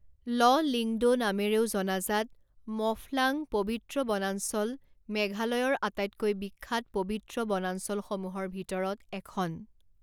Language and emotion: Assamese, neutral